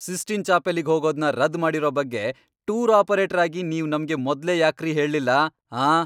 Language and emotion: Kannada, angry